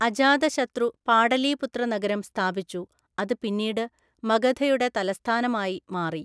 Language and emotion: Malayalam, neutral